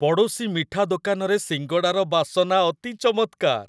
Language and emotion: Odia, happy